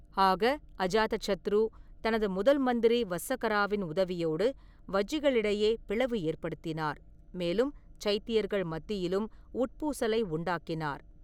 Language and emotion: Tamil, neutral